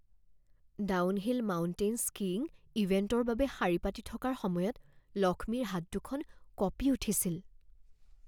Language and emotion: Assamese, fearful